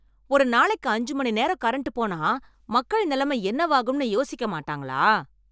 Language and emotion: Tamil, angry